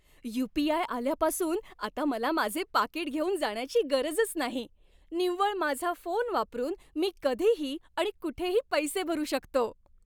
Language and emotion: Marathi, happy